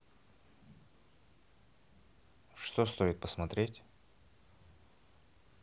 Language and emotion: Russian, neutral